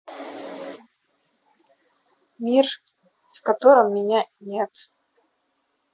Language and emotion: Russian, neutral